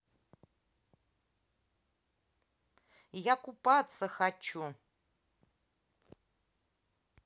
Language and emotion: Russian, neutral